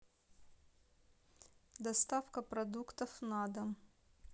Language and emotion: Russian, neutral